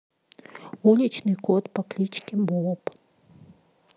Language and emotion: Russian, neutral